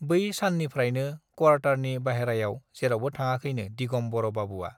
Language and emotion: Bodo, neutral